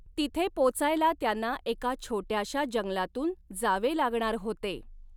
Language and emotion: Marathi, neutral